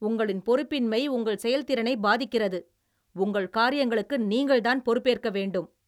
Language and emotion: Tamil, angry